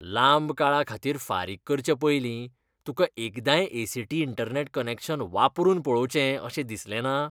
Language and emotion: Goan Konkani, disgusted